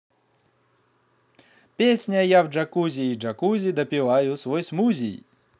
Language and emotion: Russian, positive